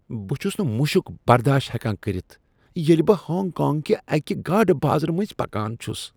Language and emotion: Kashmiri, disgusted